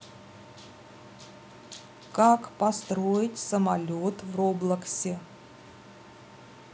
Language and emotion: Russian, neutral